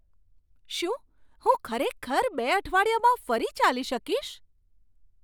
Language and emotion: Gujarati, surprised